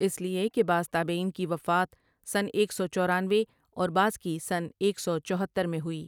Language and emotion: Urdu, neutral